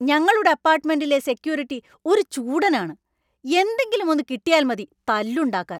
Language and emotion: Malayalam, angry